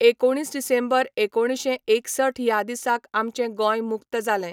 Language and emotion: Goan Konkani, neutral